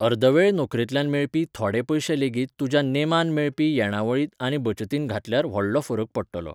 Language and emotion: Goan Konkani, neutral